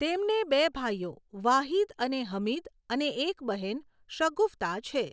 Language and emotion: Gujarati, neutral